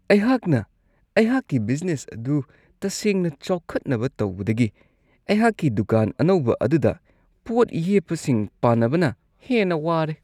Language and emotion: Manipuri, disgusted